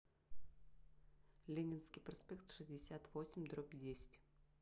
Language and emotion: Russian, neutral